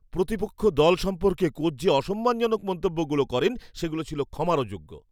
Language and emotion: Bengali, disgusted